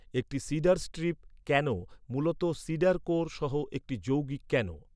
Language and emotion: Bengali, neutral